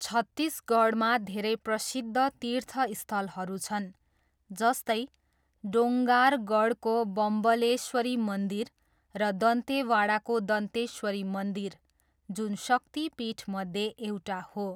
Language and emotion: Nepali, neutral